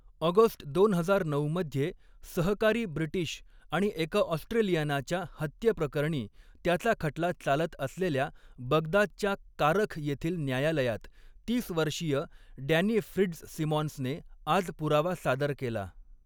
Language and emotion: Marathi, neutral